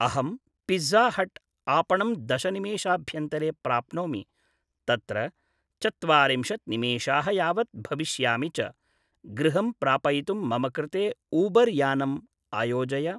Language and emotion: Sanskrit, neutral